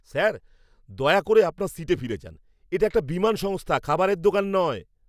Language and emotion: Bengali, angry